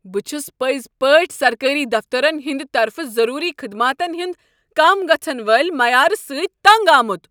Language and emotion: Kashmiri, angry